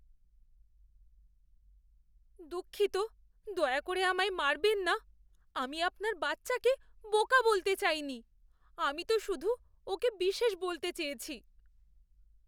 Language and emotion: Bengali, fearful